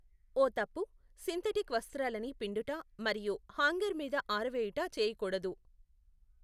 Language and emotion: Telugu, neutral